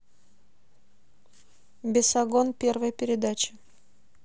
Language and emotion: Russian, neutral